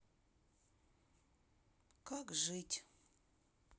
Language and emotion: Russian, sad